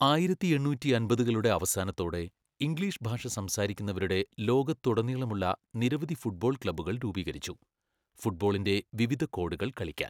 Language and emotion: Malayalam, neutral